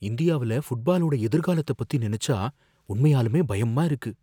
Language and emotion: Tamil, fearful